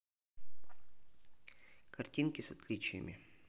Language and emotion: Russian, neutral